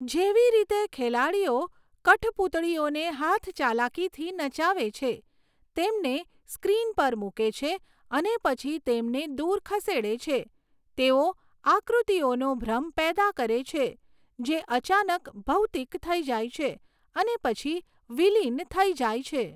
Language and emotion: Gujarati, neutral